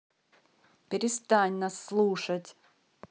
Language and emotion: Russian, angry